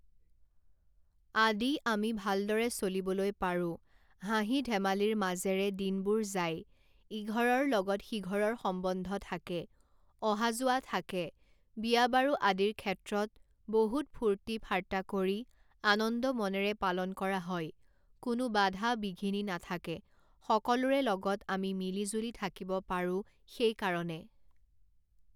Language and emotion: Assamese, neutral